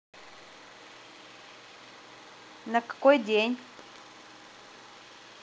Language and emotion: Russian, neutral